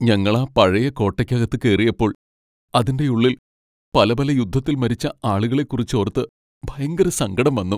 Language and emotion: Malayalam, sad